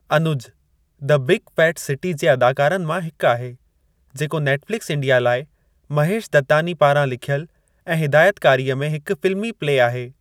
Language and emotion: Sindhi, neutral